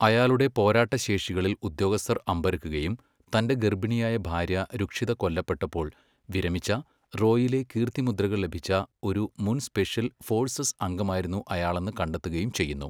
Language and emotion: Malayalam, neutral